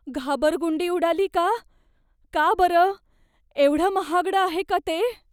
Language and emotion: Marathi, fearful